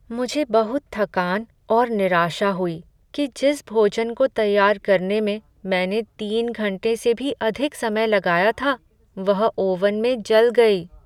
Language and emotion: Hindi, sad